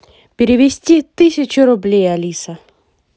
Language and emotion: Russian, positive